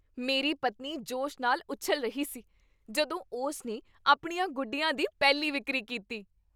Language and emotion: Punjabi, happy